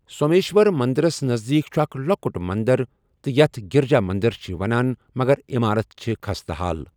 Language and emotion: Kashmiri, neutral